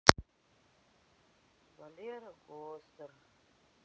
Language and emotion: Russian, sad